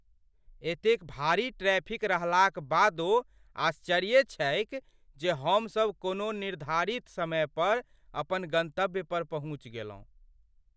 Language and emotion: Maithili, surprised